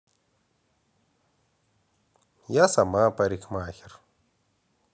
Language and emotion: Russian, positive